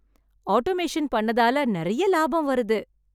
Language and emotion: Tamil, happy